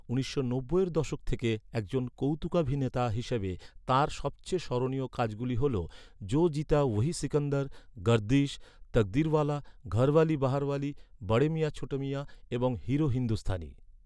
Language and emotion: Bengali, neutral